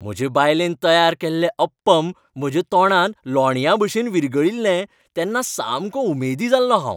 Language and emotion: Goan Konkani, happy